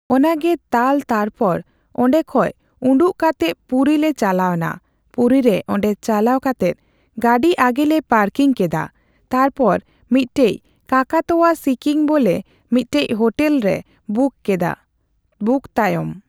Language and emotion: Santali, neutral